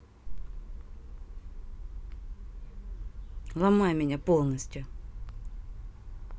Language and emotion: Russian, neutral